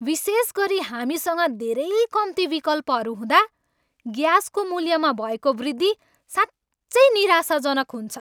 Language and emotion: Nepali, angry